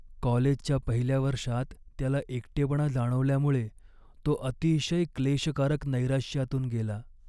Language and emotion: Marathi, sad